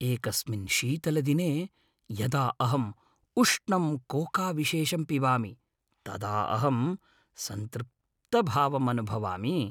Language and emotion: Sanskrit, happy